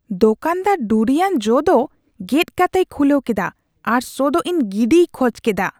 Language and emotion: Santali, disgusted